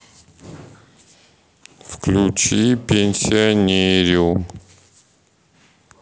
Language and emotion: Russian, sad